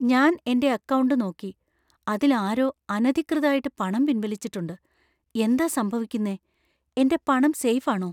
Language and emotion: Malayalam, fearful